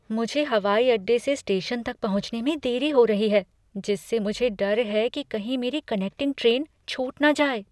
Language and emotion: Hindi, fearful